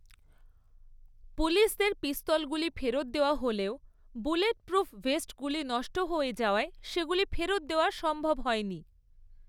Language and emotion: Bengali, neutral